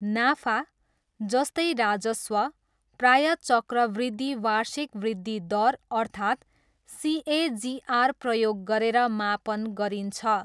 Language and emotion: Nepali, neutral